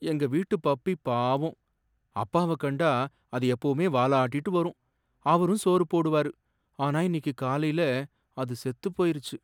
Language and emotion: Tamil, sad